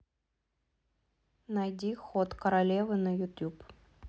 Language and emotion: Russian, neutral